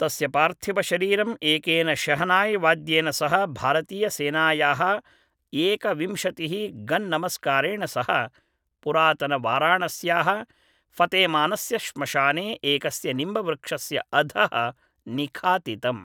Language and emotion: Sanskrit, neutral